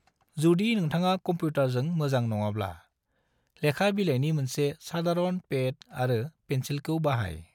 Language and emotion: Bodo, neutral